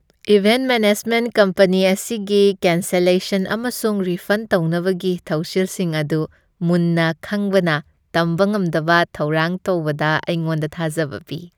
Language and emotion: Manipuri, happy